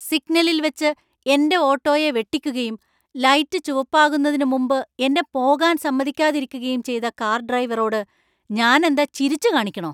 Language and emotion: Malayalam, angry